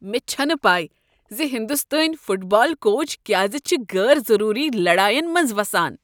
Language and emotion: Kashmiri, disgusted